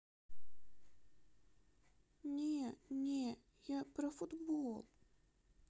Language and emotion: Russian, sad